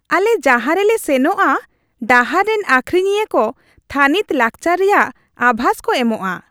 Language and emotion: Santali, happy